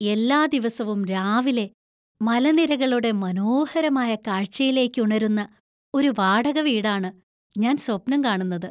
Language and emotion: Malayalam, happy